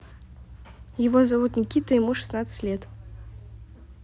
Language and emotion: Russian, neutral